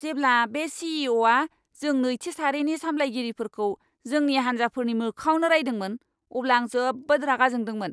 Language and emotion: Bodo, angry